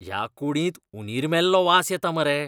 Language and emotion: Goan Konkani, disgusted